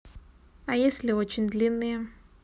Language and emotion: Russian, neutral